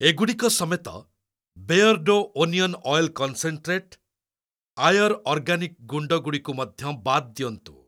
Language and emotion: Odia, neutral